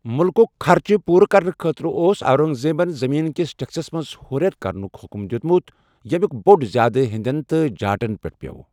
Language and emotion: Kashmiri, neutral